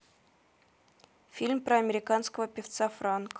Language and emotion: Russian, neutral